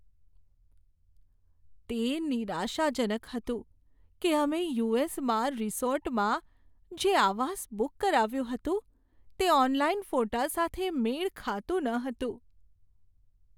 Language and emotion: Gujarati, sad